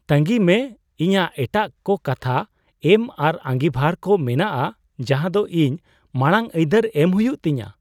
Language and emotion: Santali, surprised